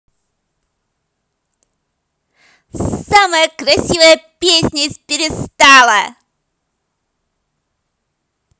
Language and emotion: Russian, positive